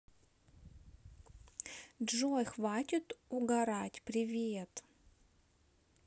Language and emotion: Russian, neutral